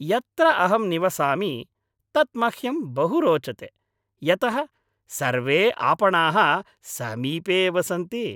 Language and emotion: Sanskrit, happy